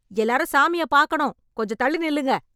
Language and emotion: Tamil, angry